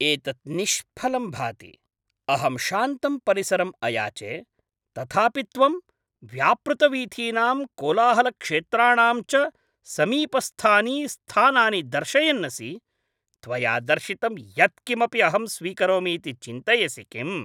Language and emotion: Sanskrit, angry